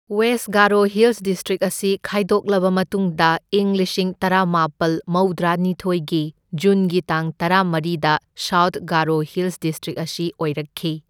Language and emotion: Manipuri, neutral